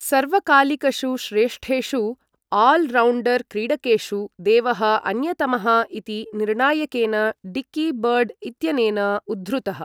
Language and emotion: Sanskrit, neutral